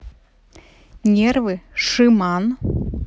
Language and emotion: Russian, neutral